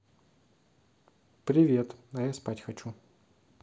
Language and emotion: Russian, neutral